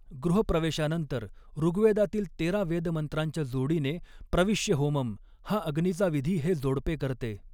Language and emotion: Marathi, neutral